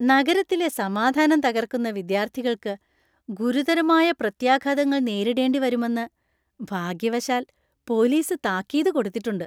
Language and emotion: Malayalam, happy